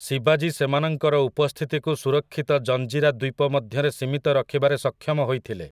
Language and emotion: Odia, neutral